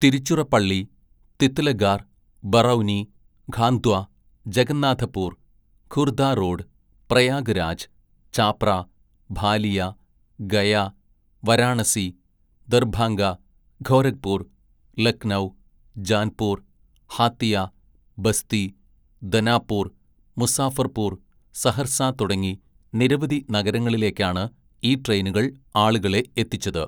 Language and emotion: Malayalam, neutral